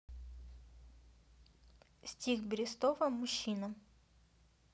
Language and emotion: Russian, neutral